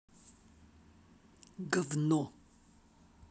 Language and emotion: Russian, angry